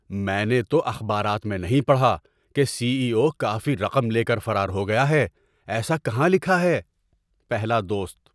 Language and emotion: Urdu, surprised